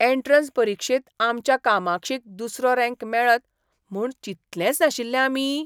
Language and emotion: Goan Konkani, surprised